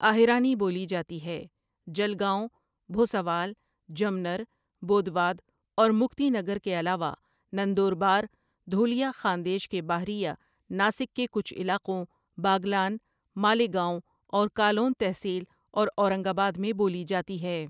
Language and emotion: Urdu, neutral